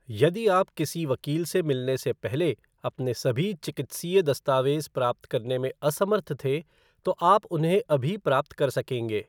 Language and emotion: Hindi, neutral